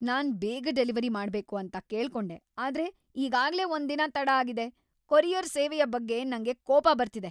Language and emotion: Kannada, angry